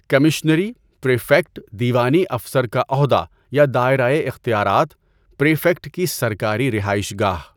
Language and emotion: Urdu, neutral